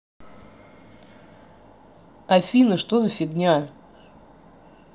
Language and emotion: Russian, angry